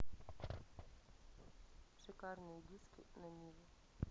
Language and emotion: Russian, neutral